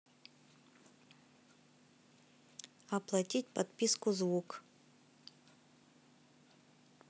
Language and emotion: Russian, neutral